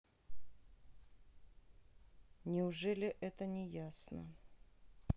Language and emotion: Russian, neutral